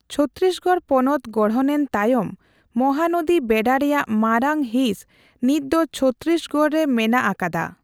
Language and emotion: Santali, neutral